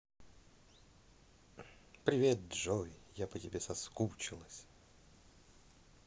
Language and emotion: Russian, positive